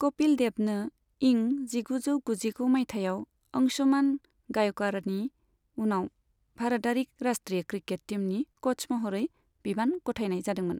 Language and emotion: Bodo, neutral